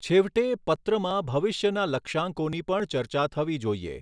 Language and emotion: Gujarati, neutral